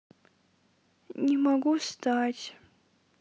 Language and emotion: Russian, sad